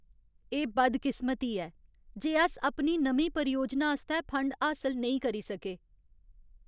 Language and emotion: Dogri, sad